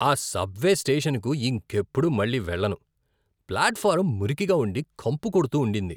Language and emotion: Telugu, disgusted